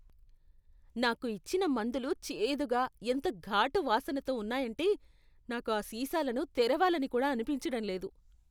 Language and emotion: Telugu, disgusted